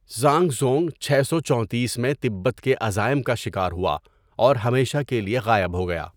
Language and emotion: Urdu, neutral